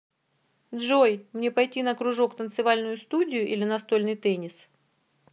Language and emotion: Russian, neutral